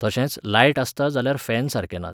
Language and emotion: Goan Konkani, neutral